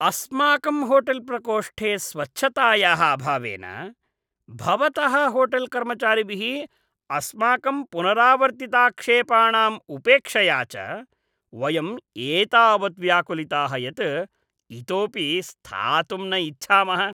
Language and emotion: Sanskrit, disgusted